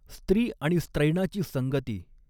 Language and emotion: Marathi, neutral